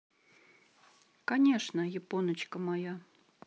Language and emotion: Russian, neutral